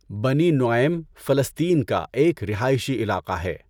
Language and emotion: Urdu, neutral